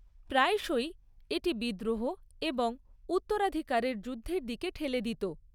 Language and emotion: Bengali, neutral